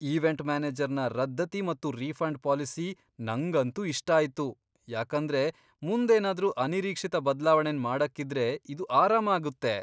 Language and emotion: Kannada, surprised